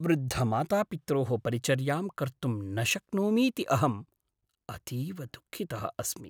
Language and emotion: Sanskrit, sad